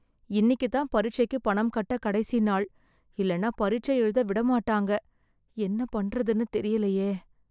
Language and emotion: Tamil, fearful